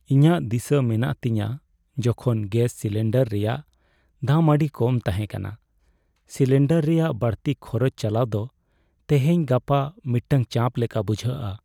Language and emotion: Santali, sad